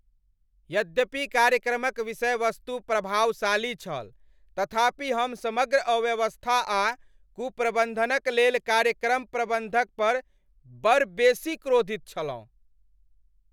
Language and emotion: Maithili, angry